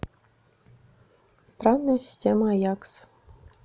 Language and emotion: Russian, neutral